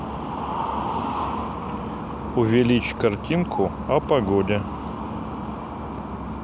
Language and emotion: Russian, neutral